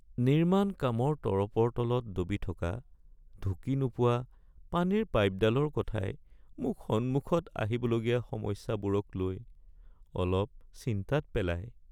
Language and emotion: Assamese, sad